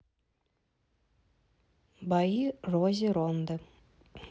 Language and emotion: Russian, neutral